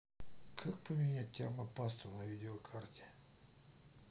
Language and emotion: Russian, neutral